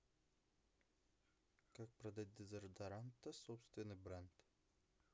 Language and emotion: Russian, neutral